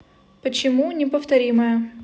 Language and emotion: Russian, neutral